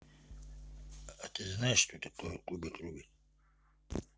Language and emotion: Russian, neutral